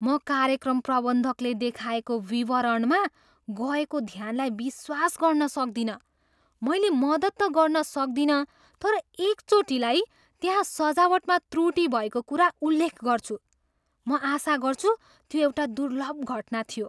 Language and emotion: Nepali, surprised